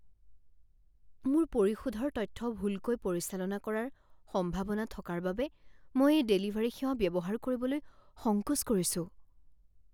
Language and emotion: Assamese, fearful